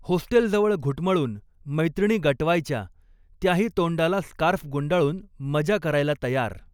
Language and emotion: Marathi, neutral